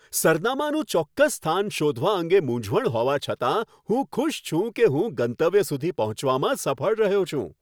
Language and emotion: Gujarati, happy